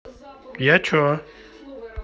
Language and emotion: Russian, neutral